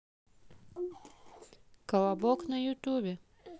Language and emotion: Russian, neutral